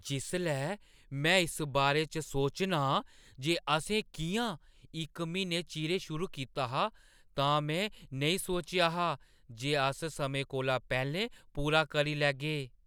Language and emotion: Dogri, surprised